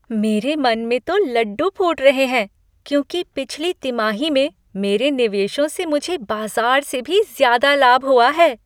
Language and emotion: Hindi, happy